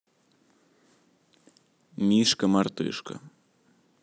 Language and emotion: Russian, neutral